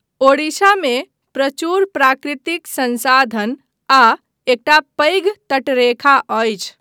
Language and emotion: Maithili, neutral